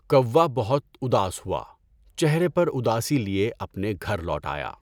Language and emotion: Urdu, neutral